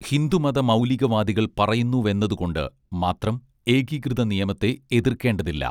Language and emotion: Malayalam, neutral